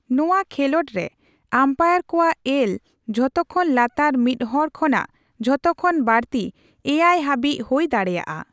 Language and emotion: Santali, neutral